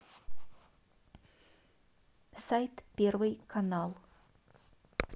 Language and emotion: Russian, neutral